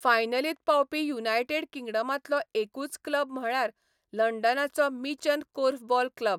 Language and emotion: Goan Konkani, neutral